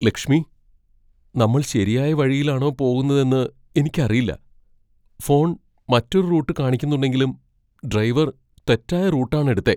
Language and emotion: Malayalam, fearful